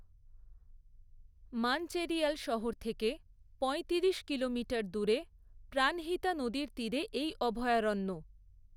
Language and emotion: Bengali, neutral